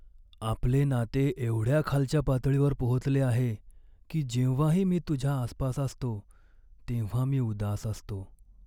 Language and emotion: Marathi, sad